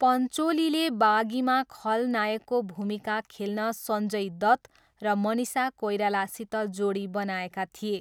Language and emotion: Nepali, neutral